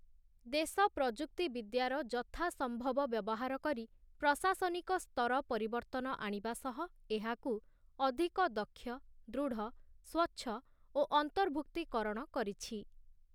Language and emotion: Odia, neutral